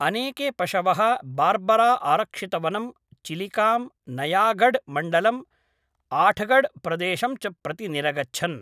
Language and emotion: Sanskrit, neutral